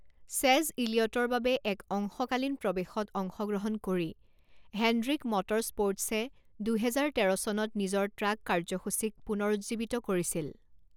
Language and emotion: Assamese, neutral